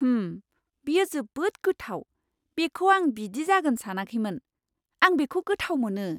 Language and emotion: Bodo, surprised